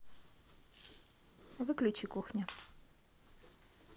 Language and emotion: Russian, neutral